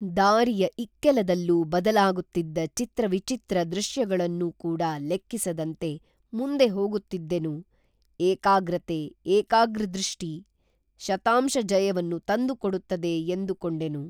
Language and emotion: Kannada, neutral